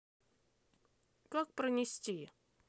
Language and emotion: Russian, neutral